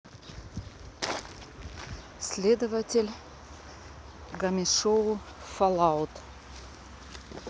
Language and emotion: Russian, neutral